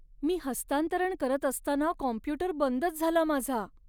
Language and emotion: Marathi, sad